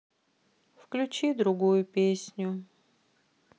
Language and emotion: Russian, sad